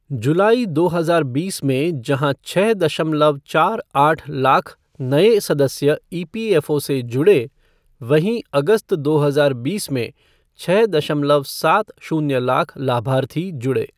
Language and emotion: Hindi, neutral